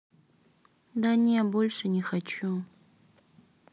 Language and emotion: Russian, sad